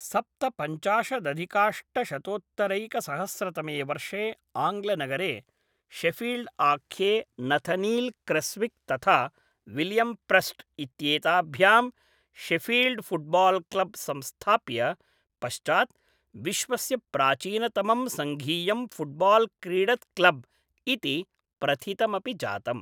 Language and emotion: Sanskrit, neutral